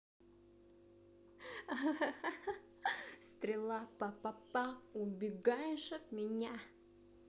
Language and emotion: Russian, positive